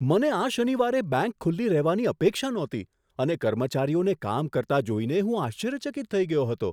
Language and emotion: Gujarati, surprised